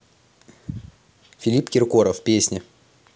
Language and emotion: Russian, positive